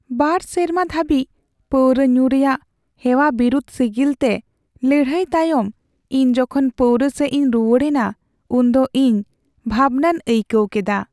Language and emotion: Santali, sad